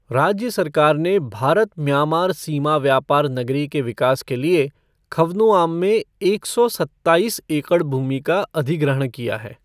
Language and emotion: Hindi, neutral